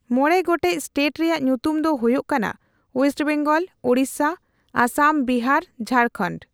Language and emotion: Santali, neutral